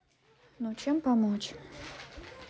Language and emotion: Russian, neutral